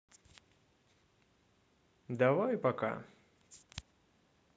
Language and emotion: Russian, neutral